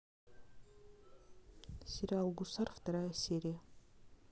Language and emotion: Russian, neutral